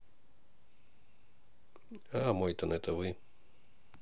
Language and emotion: Russian, neutral